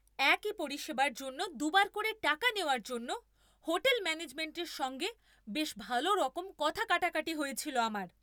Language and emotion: Bengali, angry